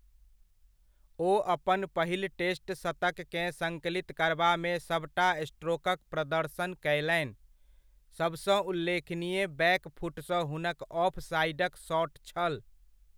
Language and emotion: Maithili, neutral